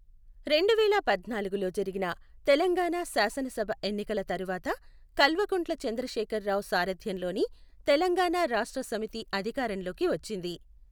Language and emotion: Telugu, neutral